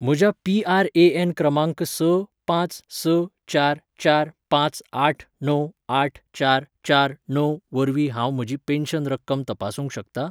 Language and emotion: Goan Konkani, neutral